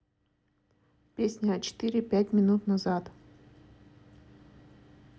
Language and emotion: Russian, neutral